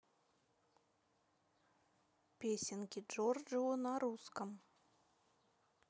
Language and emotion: Russian, neutral